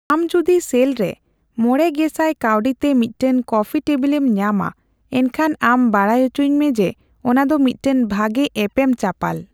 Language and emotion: Santali, neutral